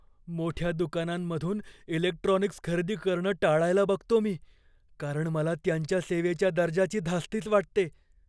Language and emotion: Marathi, fearful